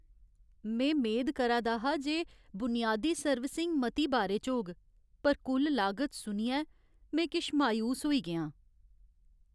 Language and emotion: Dogri, sad